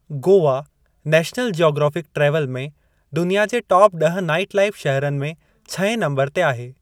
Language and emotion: Sindhi, neutral